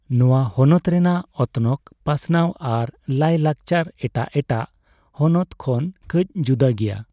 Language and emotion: Santali, neutral